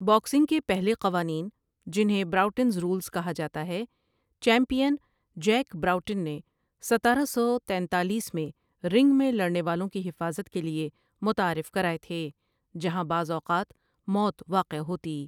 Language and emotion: Urdu, neutral